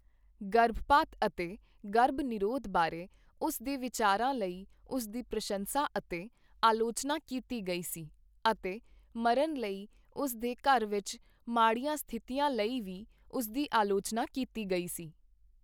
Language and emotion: Punjabi, neutral